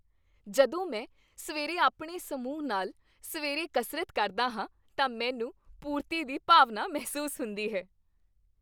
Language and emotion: Punjabi, happy